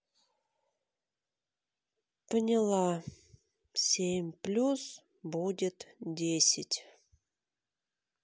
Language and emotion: Russian, sad